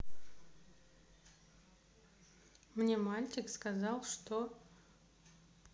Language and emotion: Russian, neutral